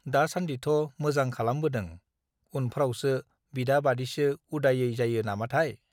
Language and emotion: Bodo, neutral